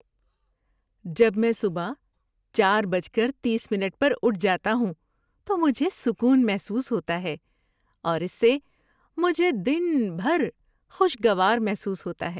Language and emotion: Urdu, happy